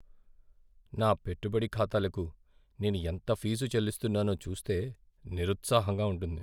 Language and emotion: Telugu, sad